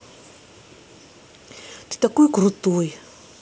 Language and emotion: Russian, positive